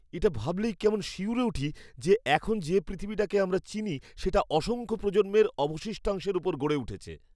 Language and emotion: Bengali, fearful